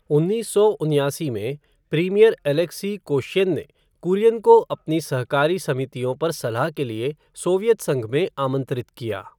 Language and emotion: Hindi, neutral